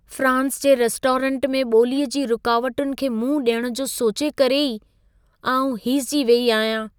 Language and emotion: Sindhi, fearful